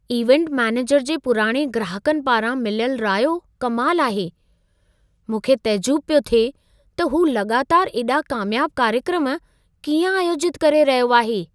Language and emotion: Sindhi, surprised